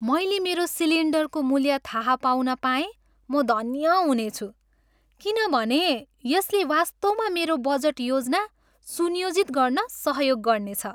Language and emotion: Nepali, happy